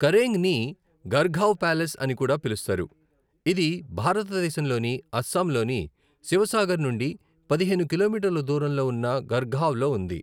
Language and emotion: Telugu, neutral